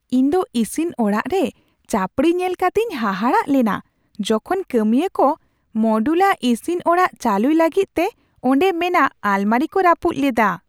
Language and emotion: Santali, surprised